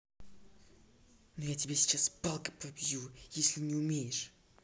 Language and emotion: Russian, angry